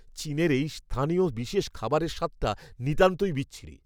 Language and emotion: Bengali, disgusted